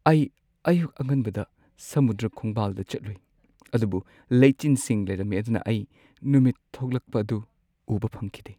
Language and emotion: Manipuri, sad